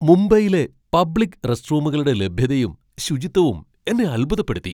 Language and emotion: Malayalam, surprised